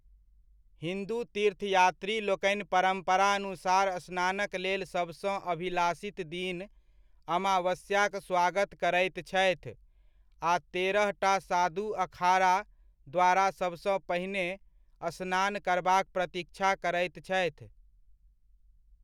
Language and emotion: Maithili, neutral